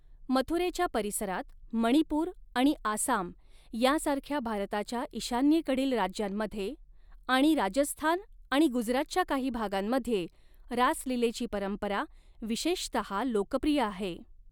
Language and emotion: Marathi, neutral